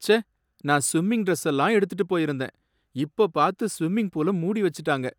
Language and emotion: Tamil, sad